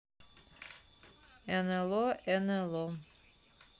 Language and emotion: Russian, neutral